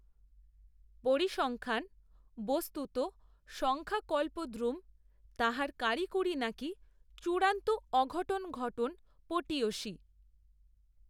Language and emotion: Bengali, neutral